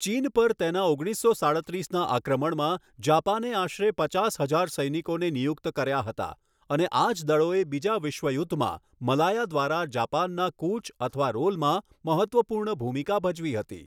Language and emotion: Gujarati, neutral